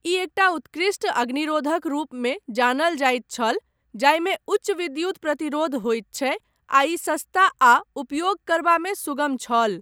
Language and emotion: Maithili, neutral